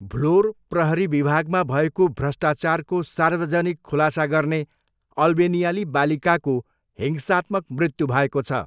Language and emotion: Nepali, neutral